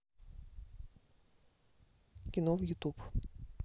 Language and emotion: Russian, neutral